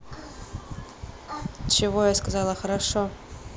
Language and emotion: Russian, neutral